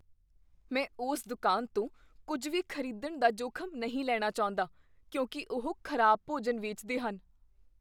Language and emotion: Punjabi, fearful